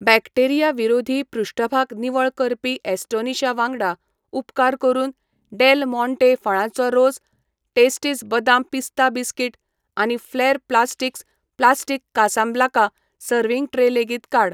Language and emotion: Goan Konkani, neutral